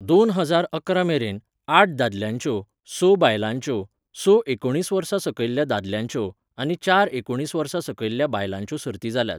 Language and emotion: Goan Konkani, neutral